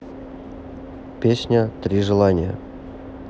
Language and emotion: Russian, neutral